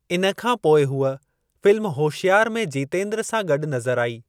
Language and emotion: Sindhi, neutral